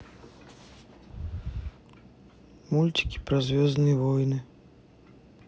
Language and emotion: Russian, sad